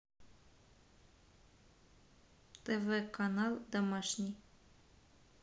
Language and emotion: Russian, neutral